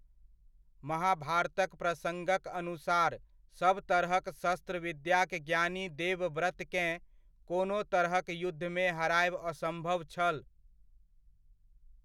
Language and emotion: Maithili, neutral